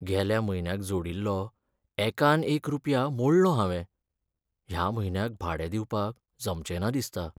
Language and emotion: Goan Konkani, sad